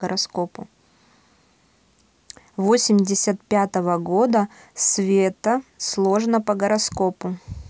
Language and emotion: Russian, neutral